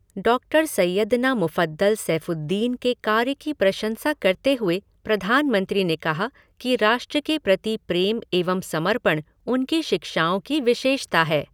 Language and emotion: Hindi, neutral